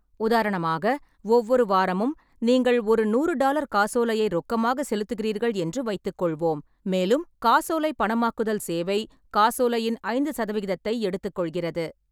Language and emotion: Tamil, neutral